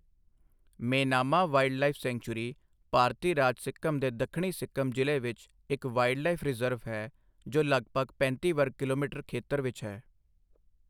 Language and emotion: Punjabi, neutral